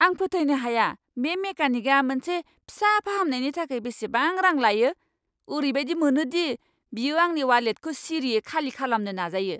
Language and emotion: Bodo, angry